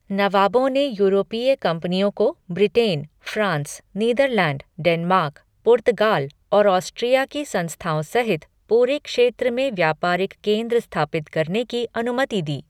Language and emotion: Hindi, neutral